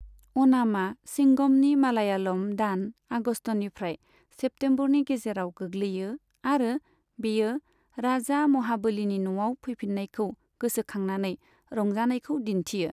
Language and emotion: Bodo, neutral